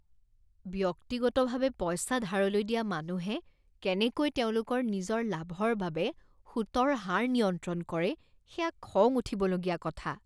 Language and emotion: Assamese, disgusted